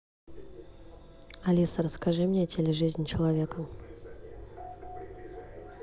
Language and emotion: Russian, neutral